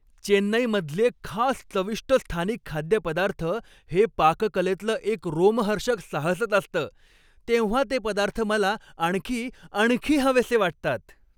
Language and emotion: Marathi, happy